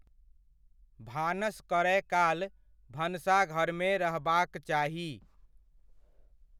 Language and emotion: Maithili, neutral